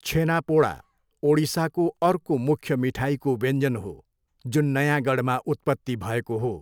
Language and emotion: Nepali, neutral